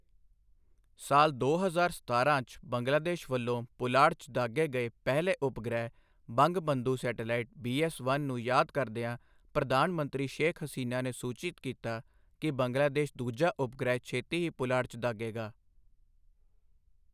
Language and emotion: Punjabi, neutral